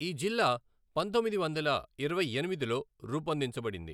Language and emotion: Telugu, neutral